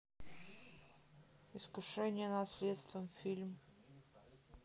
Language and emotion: Russian, neutral